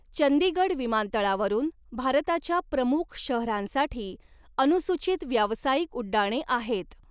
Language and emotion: Marathi, neutral